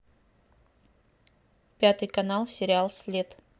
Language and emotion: Russian, neutral